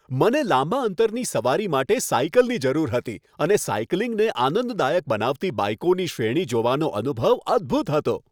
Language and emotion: Gujarati, happy